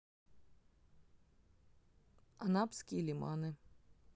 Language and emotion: Russian, neutral